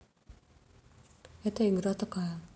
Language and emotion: Russian, neutral